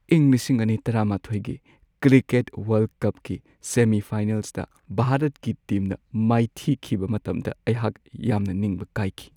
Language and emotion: Manipuri, sad